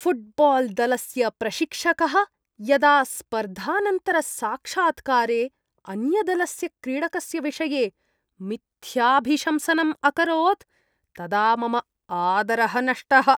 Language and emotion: Sanskrit, disgusted